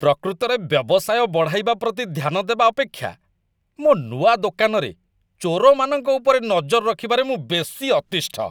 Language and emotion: Odia, disgusted